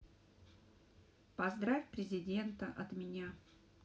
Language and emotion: Russian, neutral